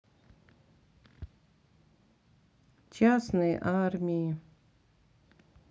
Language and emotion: Russian, sad